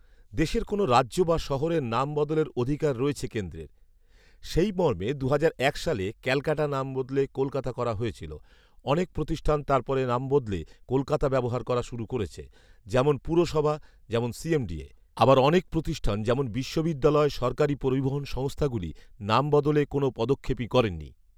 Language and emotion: Bengali, neutral